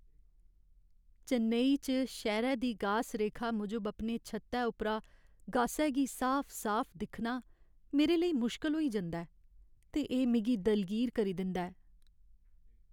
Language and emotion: Dogri, sad